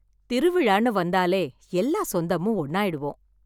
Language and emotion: Tamil, happy